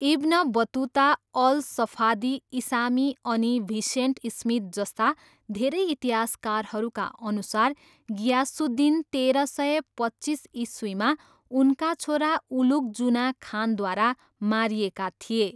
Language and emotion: Nepali, neutral